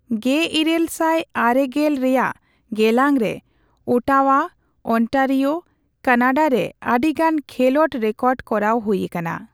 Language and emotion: Santali, neutral